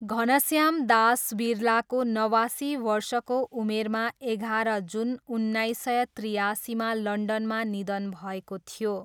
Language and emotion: Nepali, neutral